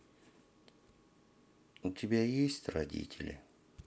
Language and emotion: Russian, sad